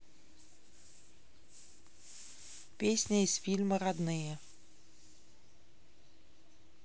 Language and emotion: Russian, neutral